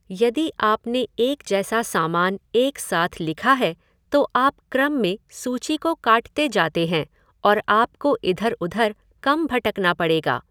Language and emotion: Hindi, neutral